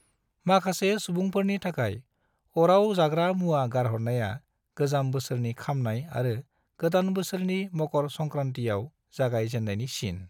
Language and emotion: Bodo, neutral